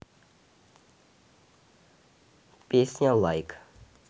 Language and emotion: Russian, neutral